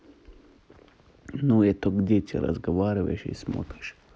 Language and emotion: Russian, neutral